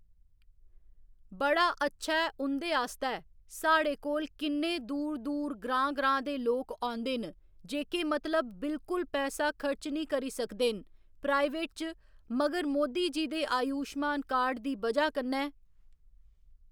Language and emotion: Dogri, neutral